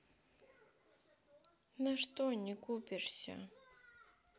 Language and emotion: Russian, sad